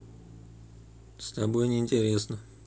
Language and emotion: Russian, neutral